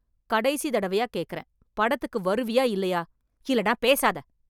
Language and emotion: Tamil, angry